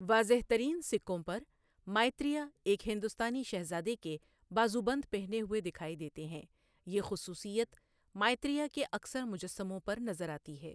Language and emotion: Urdu, neutral